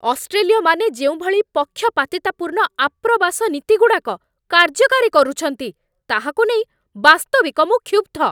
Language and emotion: Odia, angry